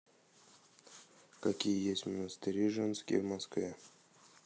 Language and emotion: Russian, neutral